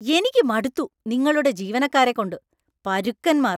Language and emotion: Malayalam, angry